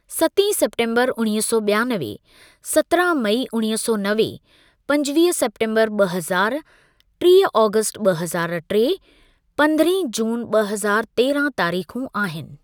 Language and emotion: Sindhi, neutral